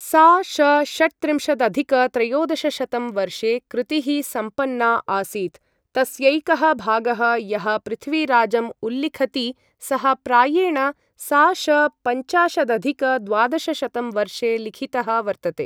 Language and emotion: Sanskrit, neutral